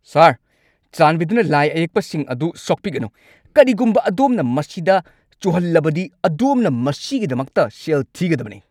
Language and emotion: Manipuri, angry